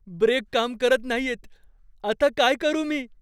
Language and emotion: Marathi, fearful